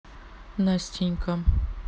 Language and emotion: Russian, neutral